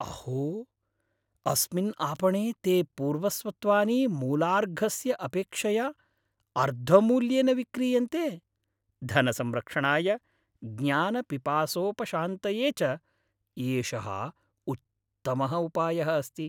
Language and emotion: Sanskrit, happy